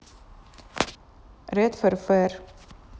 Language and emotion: Russian, neutral